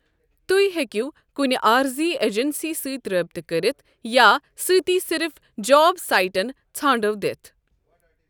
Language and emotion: Kashmiri, neutral